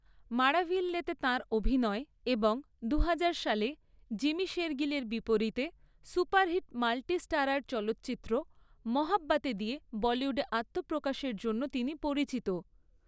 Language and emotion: Bengali, neutral